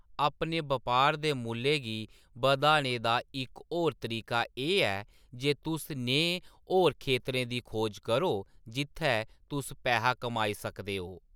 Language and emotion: Dogri, neutral